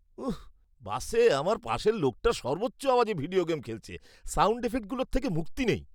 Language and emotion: Bengali, disgusted